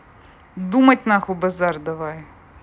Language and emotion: Russian, angry